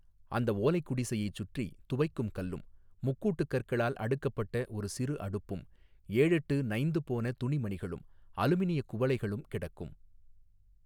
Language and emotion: Tamil, neutral